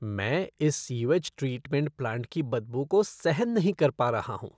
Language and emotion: Hindi, disgusted